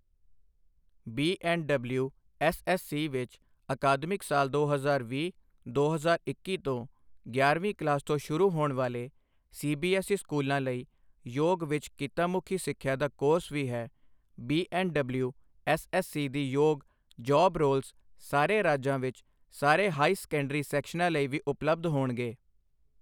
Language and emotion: Punjabi, neutral